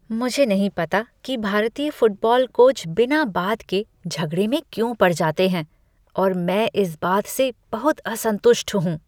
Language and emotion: Hindi, disgusted